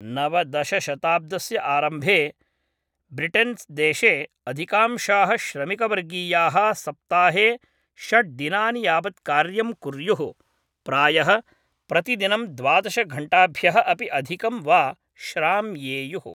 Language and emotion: Sanskrit, neutral